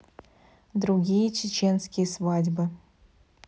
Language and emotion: Russian, neutral